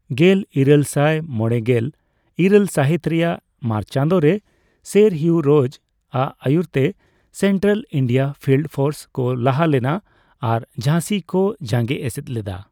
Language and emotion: Santali, neutral